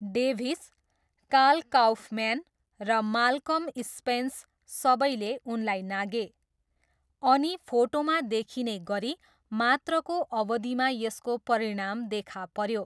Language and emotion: Nepali, neutral